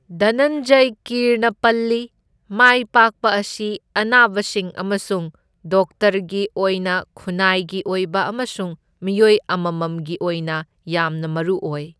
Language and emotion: Manipuri, neutral